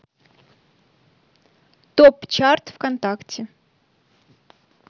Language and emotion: Russian, neutral